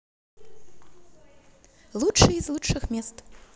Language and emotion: Russian, positive